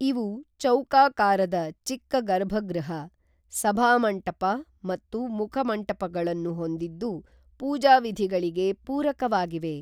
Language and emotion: Kannada, neutral